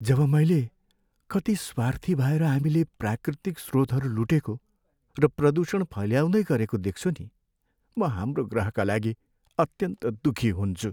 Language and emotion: Nepali, sad